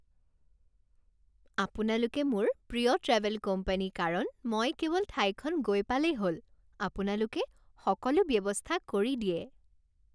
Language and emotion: Assamese, happy